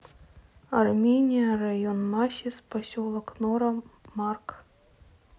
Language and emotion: Russian, neutral